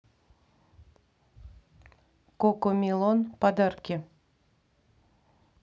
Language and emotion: Russian, neutral